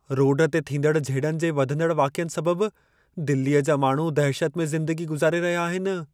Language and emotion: Sindhi, fearful